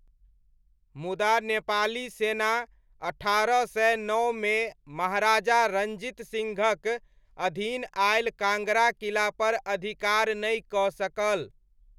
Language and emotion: Maithili, neutral